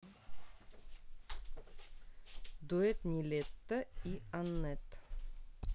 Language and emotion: Russian, neutral